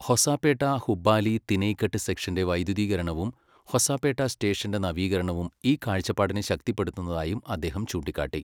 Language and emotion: Malayalam, neutral